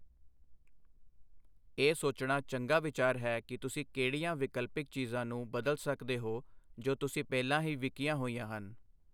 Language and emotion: Punjabi, neutral